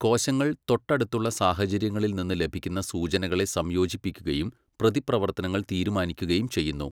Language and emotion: Malayalam, neutral